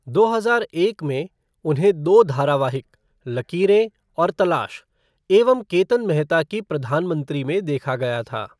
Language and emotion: Hindi, neutral